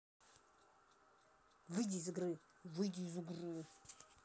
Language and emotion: Russian, angry